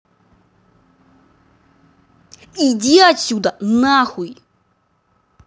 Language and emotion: Russian, angry